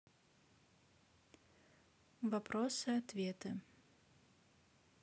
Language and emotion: Russian, neutral